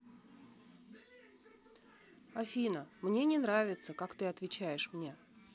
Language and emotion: Russian, sad